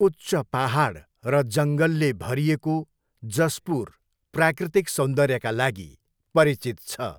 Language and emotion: Nepali, neutral